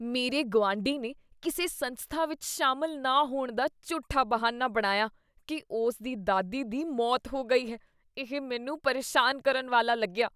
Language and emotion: Punjabi, disgusted